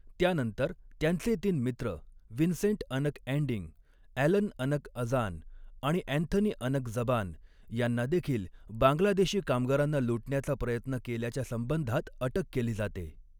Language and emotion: Marathi, neutral